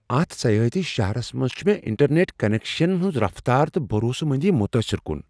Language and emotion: Kashmiri, surprised